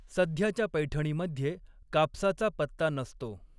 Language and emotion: Marathi, neutral